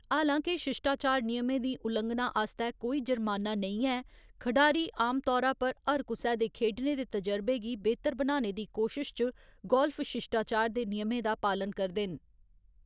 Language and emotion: Dogri, neutral